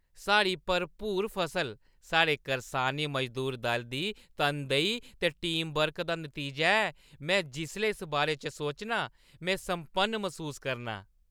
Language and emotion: Dogri, happy